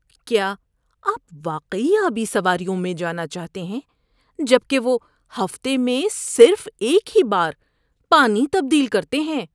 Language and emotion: Urdu, disgusted